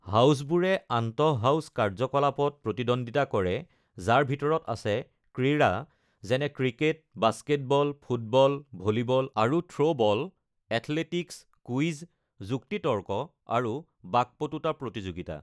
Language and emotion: Assamese, neutral